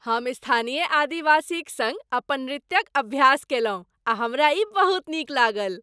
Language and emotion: Maithili, happy